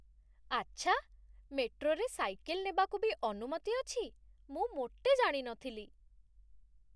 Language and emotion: Odia, surprised